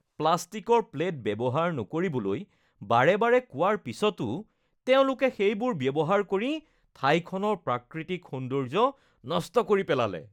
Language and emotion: Assamese, disgusted